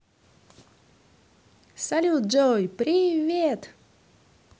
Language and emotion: Russian, positive